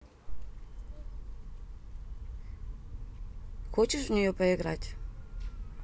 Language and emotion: Russian, neutral